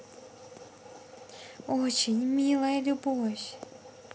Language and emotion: Russian, positive